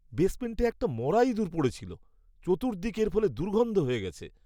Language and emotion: Bengali, disgusted